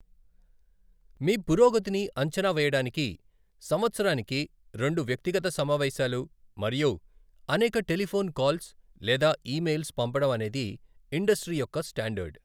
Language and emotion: Telugu, neutral